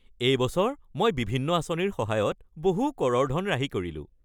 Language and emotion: Assamese, happy